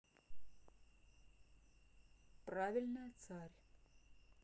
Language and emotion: Russian, neutral